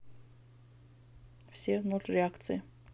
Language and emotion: Russian, neutral